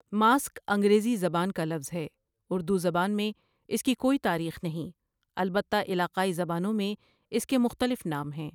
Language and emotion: Urdu, neutral